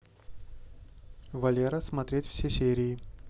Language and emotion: Russian, neutral